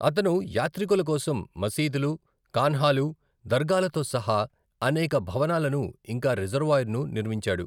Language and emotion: Telugu, neutral